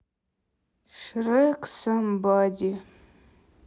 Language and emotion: Russian, sad